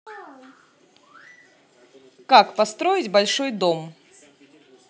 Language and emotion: Russian, positive